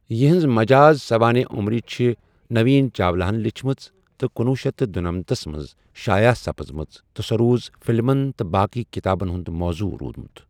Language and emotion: Kashmiri, neutral